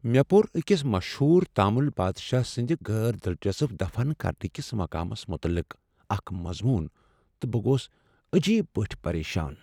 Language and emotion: Kashmiri, sad